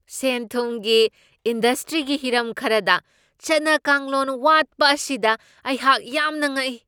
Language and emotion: Manipuri, surprised